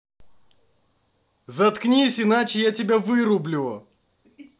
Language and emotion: Russian, angry